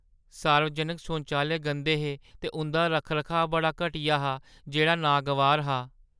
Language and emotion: Dogri, sad